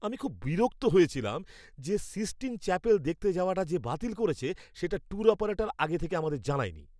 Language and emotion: Bengali, angry